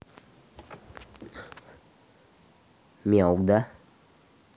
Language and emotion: Russian, neutral